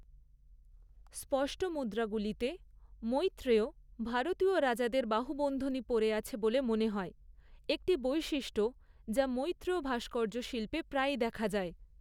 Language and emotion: Bengali, neutral